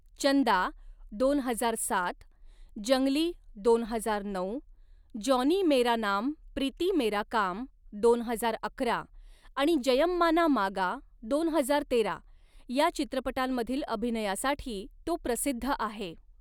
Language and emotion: Marathi, neutral